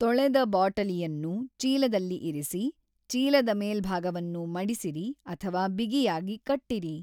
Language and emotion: Kannada, neutral